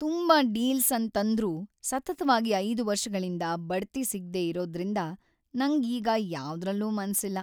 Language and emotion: Kannada, sad